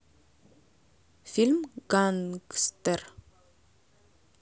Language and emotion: Russian, neutral